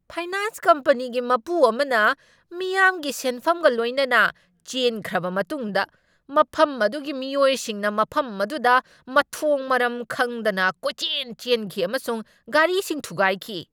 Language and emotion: Manipuri, angry